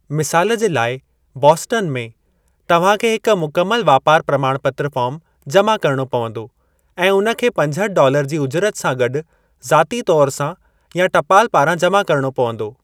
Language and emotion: Sindhi, neutral